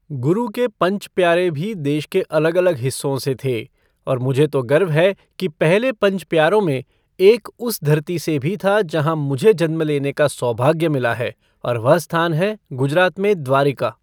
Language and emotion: Hindi, neutral